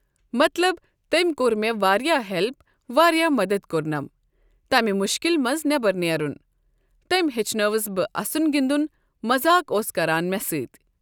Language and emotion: Kashmiri, neutral